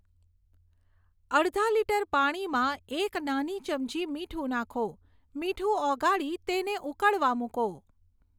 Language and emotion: Gujarati, neutral